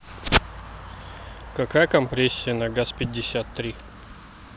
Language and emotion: Russian, neutral